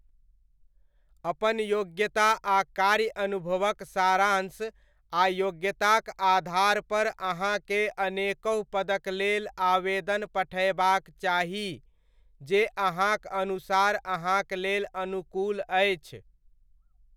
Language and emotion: Maithili, neutral